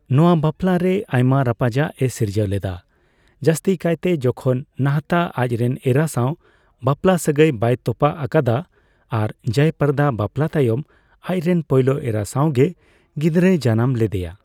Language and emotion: Santali, neutral